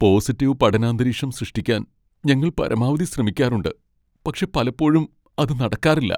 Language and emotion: Malayalam, sad